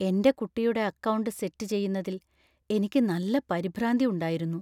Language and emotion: Malayalam, fearful